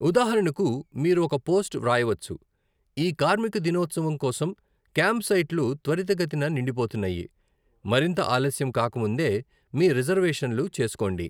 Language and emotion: Telugu, neutral